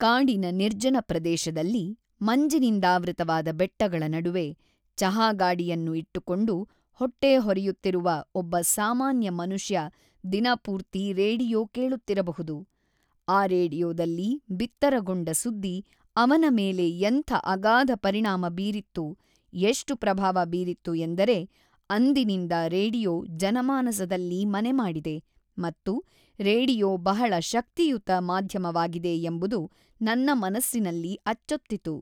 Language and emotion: Kannada, neutral